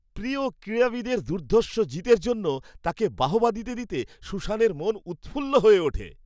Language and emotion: Bengali, happy